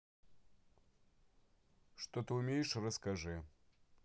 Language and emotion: Russian, neutral